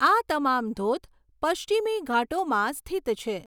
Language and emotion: Gujarati, neutral